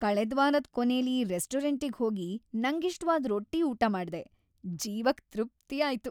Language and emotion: Kannada, happy